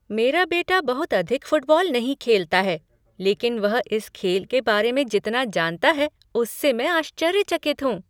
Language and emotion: Hindi, surprised